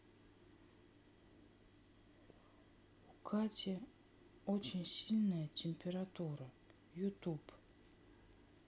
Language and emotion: Russian, sad